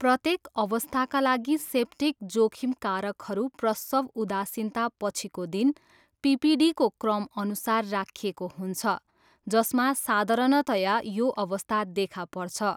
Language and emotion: Nepali, neutral